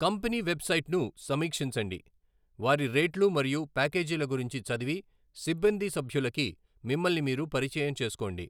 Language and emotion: Telugu, neutral